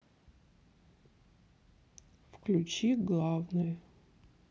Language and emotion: Russian, sad